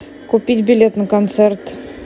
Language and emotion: Russian, neutral